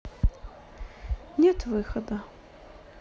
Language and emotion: Russian, sad